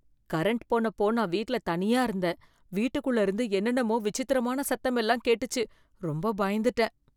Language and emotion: Tamil, fearful